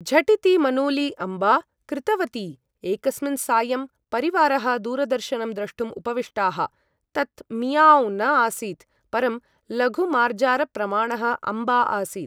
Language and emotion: Sanskrit, neutral